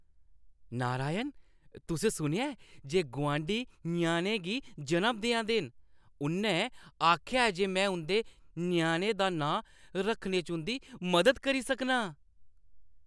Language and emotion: Dogri, happy